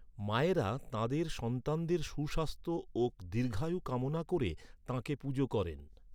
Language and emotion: Bengali, neutral